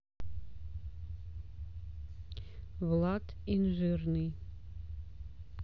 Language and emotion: Russian, neutral